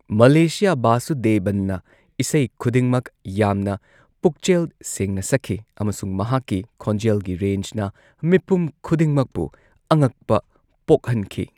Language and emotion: Manipuri, neutral